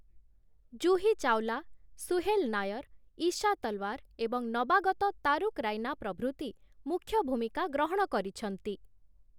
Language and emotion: Odia, neutral